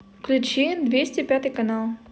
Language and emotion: Russian, neutral